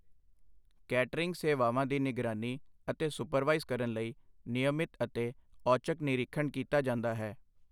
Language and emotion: Punjabi, neutral